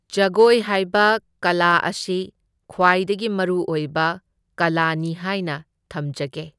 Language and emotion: Manipuri, neutral